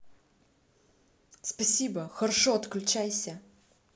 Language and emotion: Russian, neutral